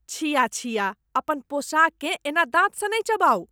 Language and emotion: Maithili, disgusted